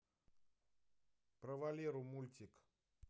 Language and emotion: Russian, neutral